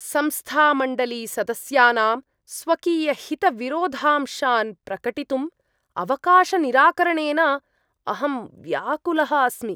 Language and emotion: Sanskrit, disgusted